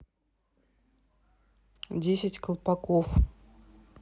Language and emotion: Russian, neutral